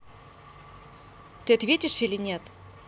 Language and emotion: Russian, angry